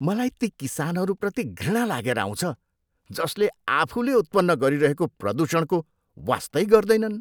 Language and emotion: Nepali, disgusted